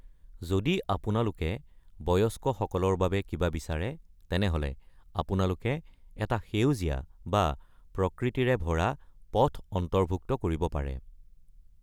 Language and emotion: Assamese, neutral